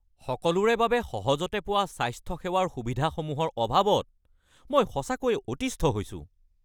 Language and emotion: Assamese, angry